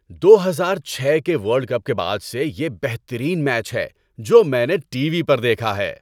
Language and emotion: Urdu, happy